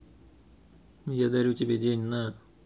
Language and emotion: Russian, neutral